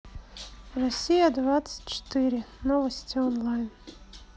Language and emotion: Russian, neutral